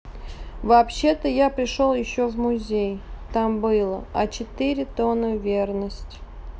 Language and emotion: Russian, neutral